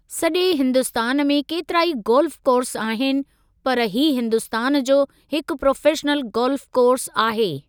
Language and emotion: Sindhi, neutral